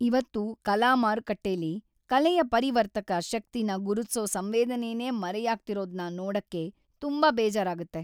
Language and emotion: Kannada, sad